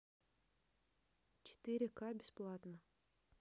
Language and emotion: Russian, neutral